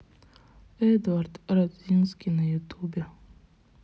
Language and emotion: Russian, sad